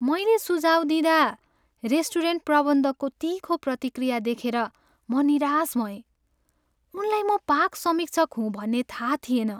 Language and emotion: Nepali, sad